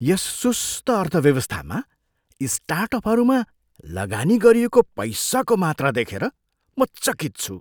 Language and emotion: Nepali, surprised